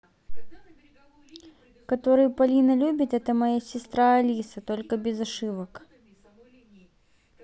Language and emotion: Russian, neutral